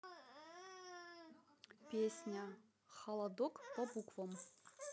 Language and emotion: Russian, neutral